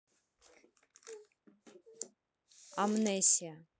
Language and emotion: Russian, neutral